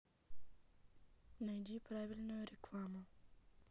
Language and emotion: Russian, neutral